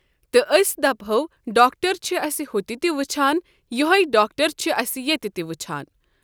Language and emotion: Kashmiri, neutral